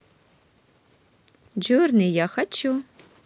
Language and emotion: Russian, positive